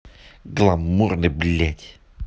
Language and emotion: Russian, angry